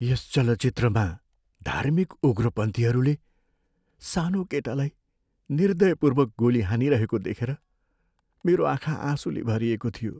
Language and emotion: Nepali, sad